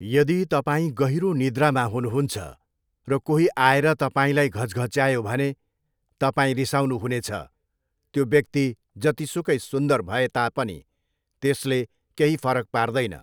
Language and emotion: Nepali, neutral